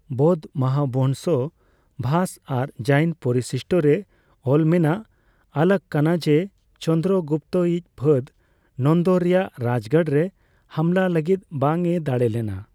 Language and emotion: Santali, neutral